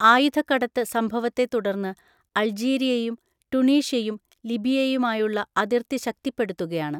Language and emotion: Malayalam, neutral